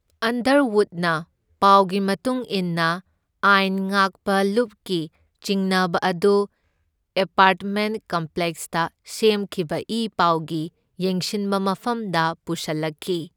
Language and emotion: Manipuri, neutral